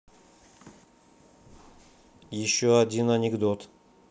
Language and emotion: Russian, neutral